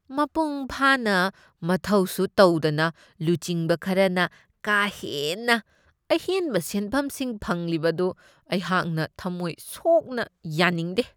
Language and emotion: Manipuri, disgusted